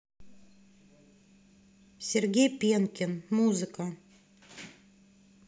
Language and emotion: Russian, neutral